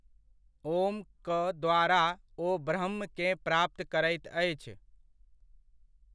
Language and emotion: Maithili, neutral